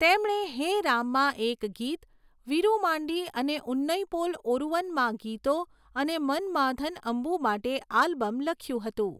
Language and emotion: Gujarati, neutral